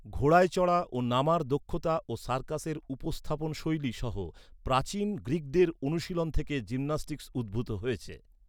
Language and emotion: Bengali, neutral